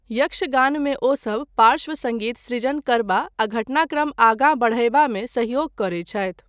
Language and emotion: Maithili, neutral